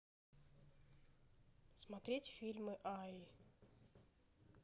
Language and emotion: Russian, neutral